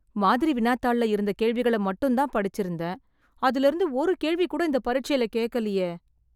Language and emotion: Tamil, sad